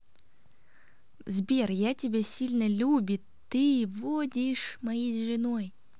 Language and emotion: Russian, positive